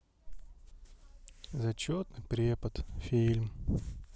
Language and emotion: Russian, sad